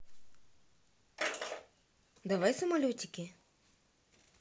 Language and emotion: Russian, neutral